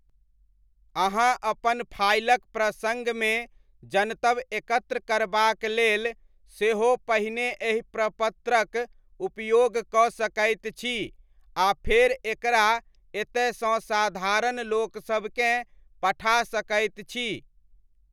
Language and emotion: Maithili, neutral